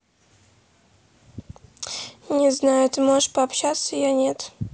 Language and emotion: Russian, neutral